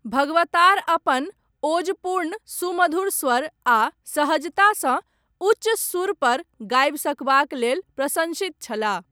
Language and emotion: Maithili, neutral